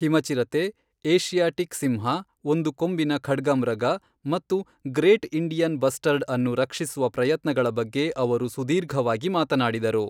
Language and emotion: Kannada, neutral